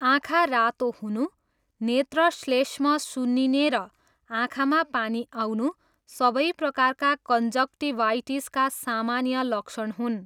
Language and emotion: Nepali, neutral